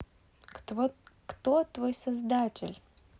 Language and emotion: Russian, neutral